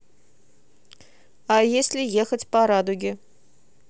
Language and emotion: Russian, neutral